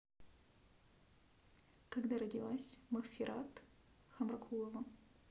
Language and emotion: Russian, neutral